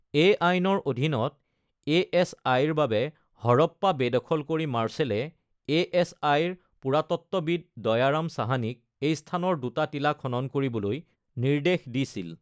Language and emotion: Assamese, neutral